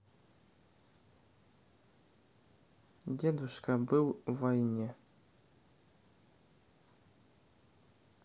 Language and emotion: Russian, neutral